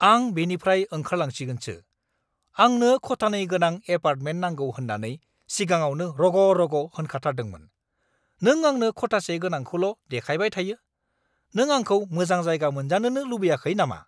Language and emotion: Bodo, angry